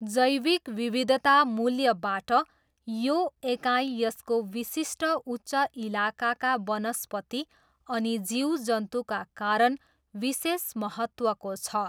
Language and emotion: Nepali, neutral